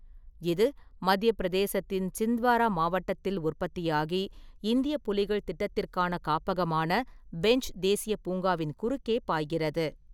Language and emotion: Tamil, neutral